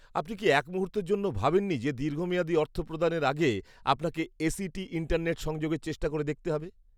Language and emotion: Bengali, disgusted